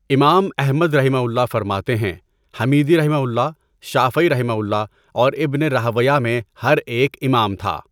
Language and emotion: Urdu, neutral